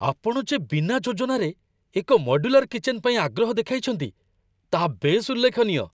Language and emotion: Odia, surprised